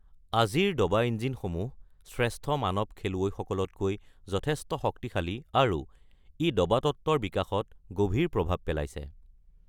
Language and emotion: Assamese, neutral